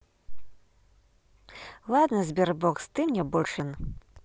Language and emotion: Russian, positive